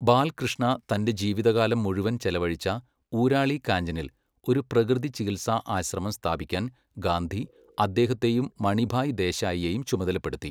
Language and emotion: Malayalam, neutral